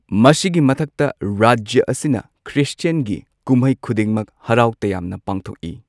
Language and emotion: Manipuri, neutral